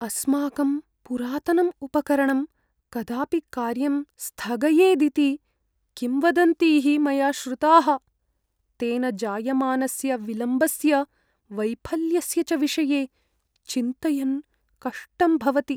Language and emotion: Sanskrit, fearful